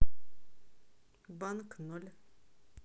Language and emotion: Russian, neutral